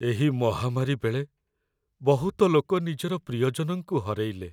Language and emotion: Odia, sad